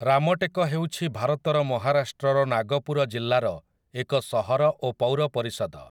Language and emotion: Odia, neutral